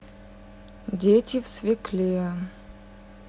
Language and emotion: Russian, neutral